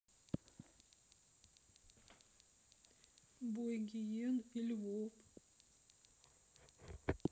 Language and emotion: Russian, neutral